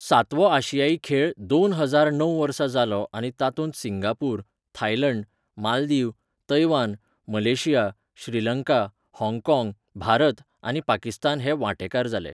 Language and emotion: Goan Konkani, neutral